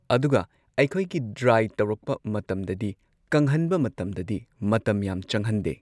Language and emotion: Manipuri, neutral